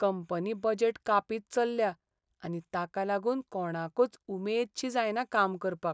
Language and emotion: Goan Konkani, sad